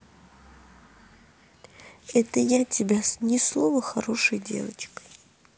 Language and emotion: Russian, neutral